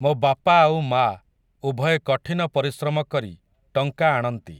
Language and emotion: Odia, neutral